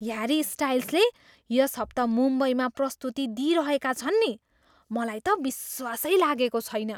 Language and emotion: Nepali, surprised